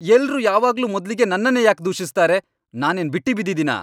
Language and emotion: Kannada, angry